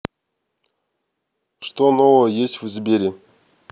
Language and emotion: Russian, neutral